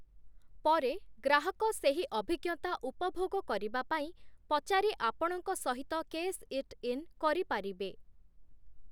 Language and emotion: Odia, neutral